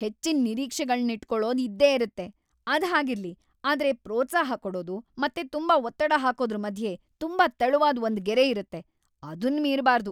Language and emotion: Kannada, angry